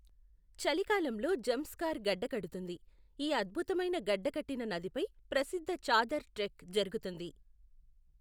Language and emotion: Telugu, neutral